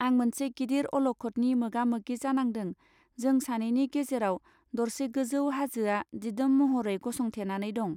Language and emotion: Bodo, neutral